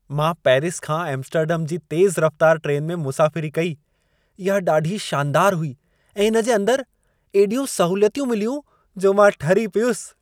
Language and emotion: Sindhi, happy